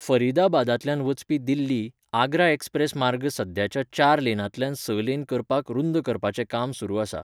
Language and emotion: Goan Konkani, neutral